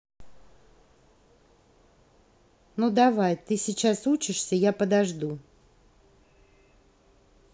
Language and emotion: Russian, neutral